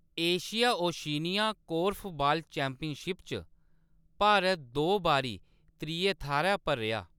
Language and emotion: Dogri, neutral